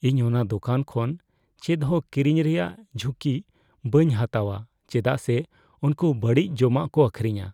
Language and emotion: Santali, fearful